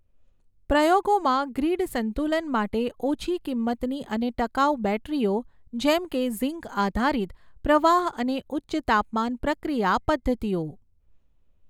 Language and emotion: Gujarati, neutral